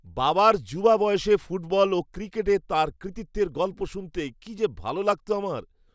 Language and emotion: Bengali, happy